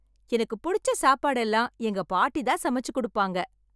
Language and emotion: Tamil, happy